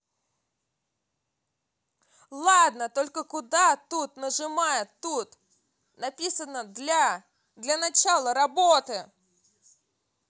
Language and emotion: Russian, angry